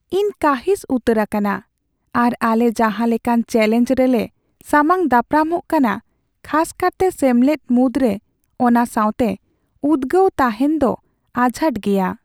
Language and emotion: Santali, sad